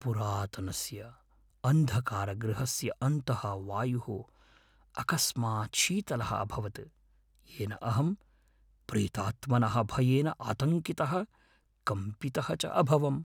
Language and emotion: Sanskrit, fearful